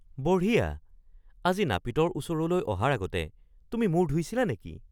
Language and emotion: Assamese, surprised